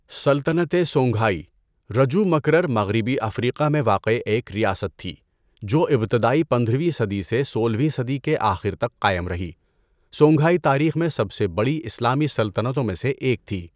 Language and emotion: Urdu, neutral